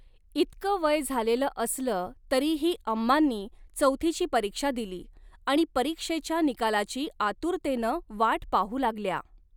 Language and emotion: Marathi, neutral